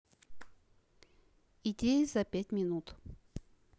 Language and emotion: Russian, neutral